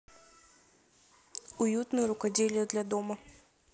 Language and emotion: Russian, neutral